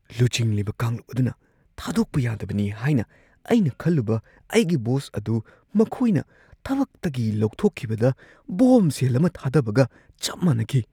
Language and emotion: Manipuri, surprised